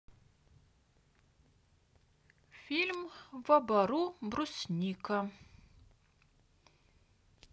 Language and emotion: Russian, neutral